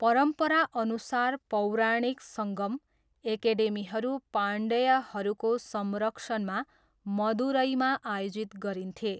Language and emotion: Nepali, neutral